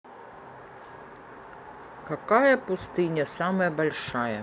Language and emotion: Russian, neutral